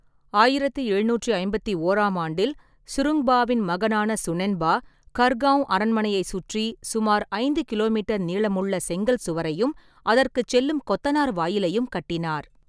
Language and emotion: Tamil, neutral